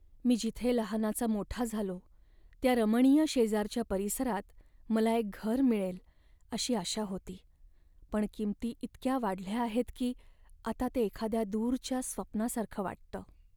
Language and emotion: Marathi, sad